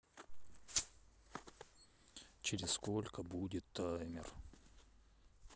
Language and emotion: Russian, sad